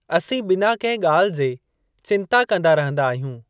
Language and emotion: Sindhi, neutral